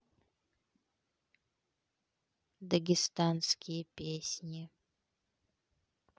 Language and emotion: Russian, neutral